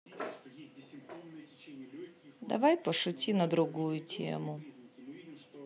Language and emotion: Russian, sad